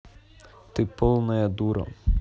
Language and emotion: Russian, neutral